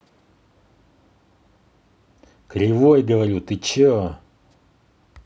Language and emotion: Russian, angry